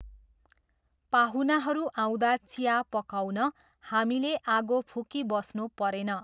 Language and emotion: Nepali, neutral